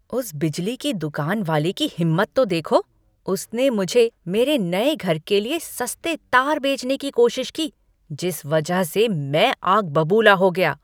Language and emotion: Hindi, angry